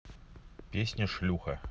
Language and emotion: Russian, neutral